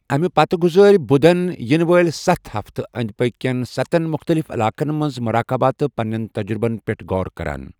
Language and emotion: Kashmiri, neutral